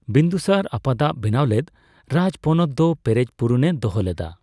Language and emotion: Santali, neutral